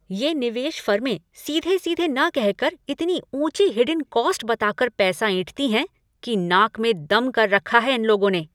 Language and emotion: Hindi, angry